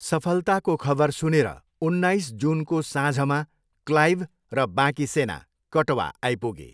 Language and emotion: Nepali, neutral